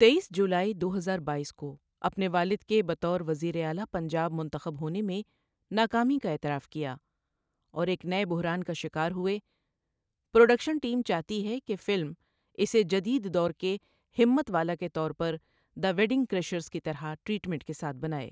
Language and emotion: Urdu, neutral